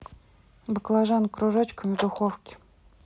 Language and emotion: Russian, neutral